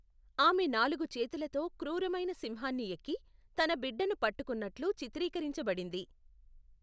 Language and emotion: Telugu, neutral